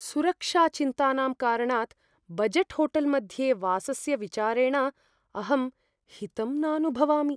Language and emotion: Sanskrit, fearful